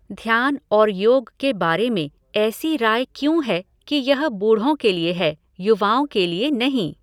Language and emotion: Hindi, neutral